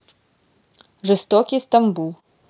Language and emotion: Russian, neutral